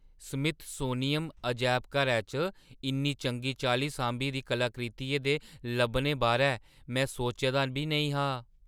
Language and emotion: Dogri, surprised